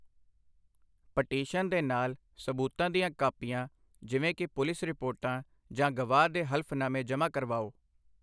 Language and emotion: Punjabi, neutral